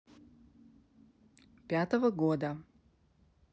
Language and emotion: Russian, neutral